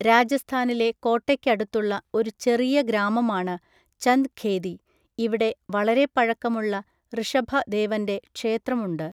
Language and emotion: Malayalam, neutral